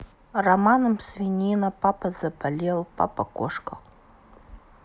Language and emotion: Russian, sad